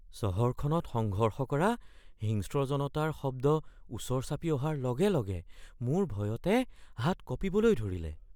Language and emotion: Assamese, fearful